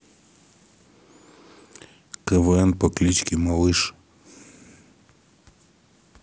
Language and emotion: Russian, neutral